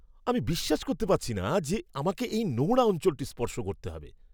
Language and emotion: Bengali, disgusted